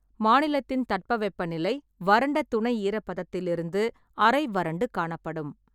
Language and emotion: Tamil, neutral